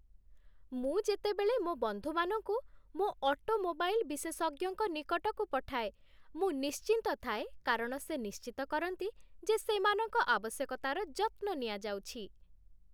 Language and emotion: Odia, happy